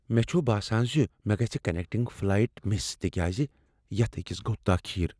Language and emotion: Kashmiri, fearful